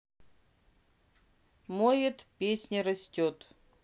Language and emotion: Russian, neutral